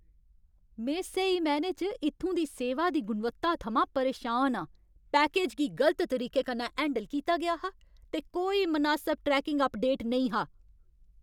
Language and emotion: Dogri, angry